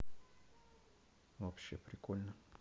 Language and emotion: Russian, neutral